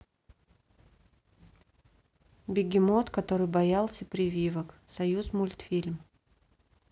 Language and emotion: Russian, neutral